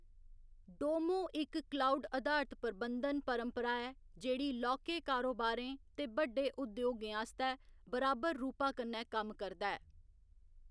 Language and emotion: Dogri, neutral